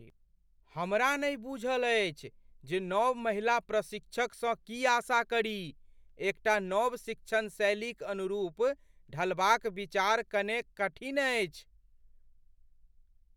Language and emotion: Maithili, fearful